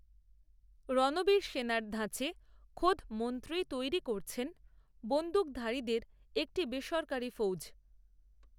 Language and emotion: Bengali, neutral